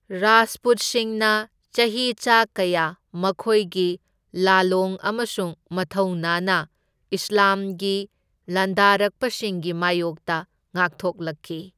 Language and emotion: Manipuri, neutral